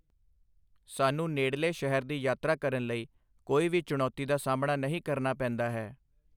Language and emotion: Punjabi, neutral